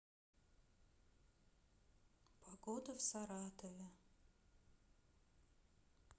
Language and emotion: Russian, sad